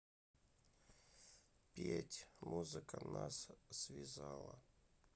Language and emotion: Russian, sad